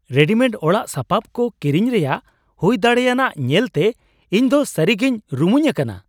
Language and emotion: Santali, surprised